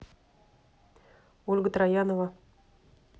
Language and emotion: Russian, neutral